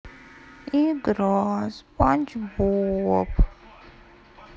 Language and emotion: Russian, sad